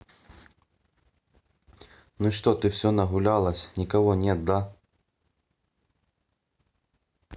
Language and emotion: Russian, neutral